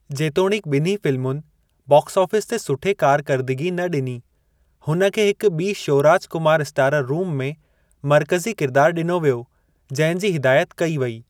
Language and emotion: Sindhi, neutral